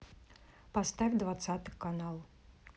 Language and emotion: Russian, neutral